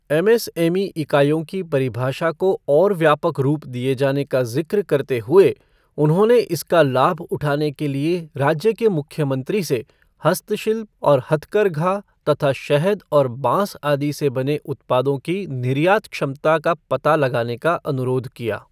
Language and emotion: Hindi, neutral